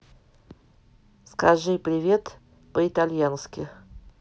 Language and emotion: Russian, neutral